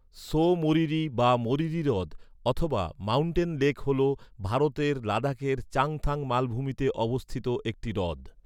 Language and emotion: Bengali, neutral